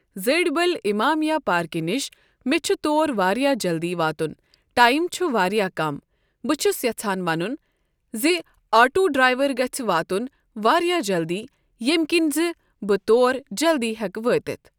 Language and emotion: Kashmiri, neutral